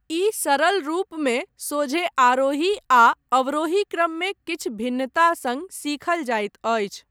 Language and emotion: Maithili, neutral